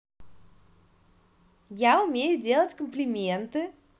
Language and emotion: Russian, positive